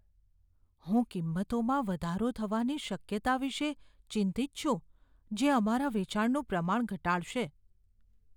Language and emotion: Gujarati, fearful